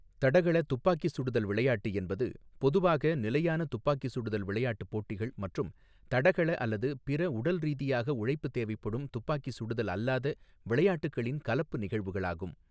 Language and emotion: Tamil, neutral